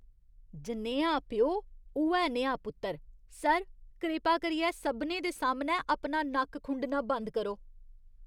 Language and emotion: Dogri, disgusted